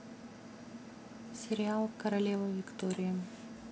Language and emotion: Russian, neutral